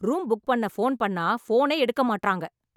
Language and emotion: Tamil, angry